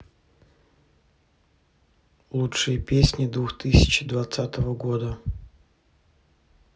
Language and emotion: Russian, neutral